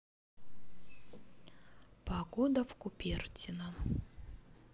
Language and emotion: Russian, neutral